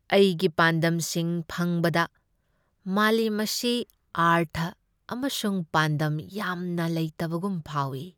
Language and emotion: Manipuri, sad